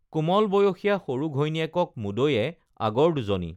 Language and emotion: Assamese, neutral